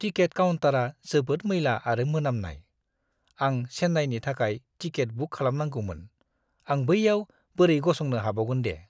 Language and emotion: Bodo, disgusted